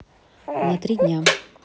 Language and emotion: Russian, neutral